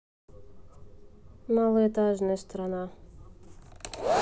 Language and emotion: Russian, neutral